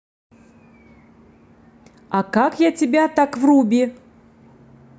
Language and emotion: Russian, positive